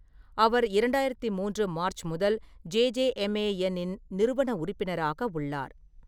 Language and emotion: Tamil, neutral